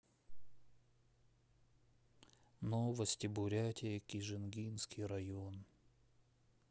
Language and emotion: Russian, sad